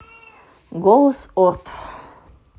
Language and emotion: Russian, neutral